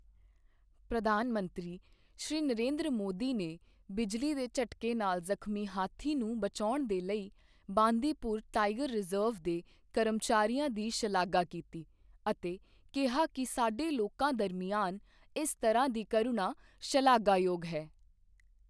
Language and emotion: Punjabi, neutral